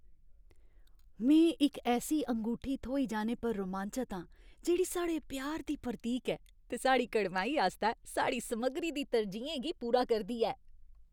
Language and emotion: Dogri, happy